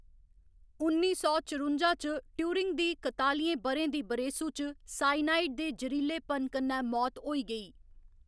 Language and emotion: Dogri, neutral